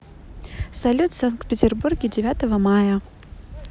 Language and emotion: Russian, positive